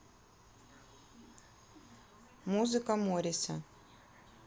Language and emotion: Russian, neutral